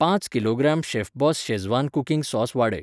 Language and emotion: Goan Konkani, neutral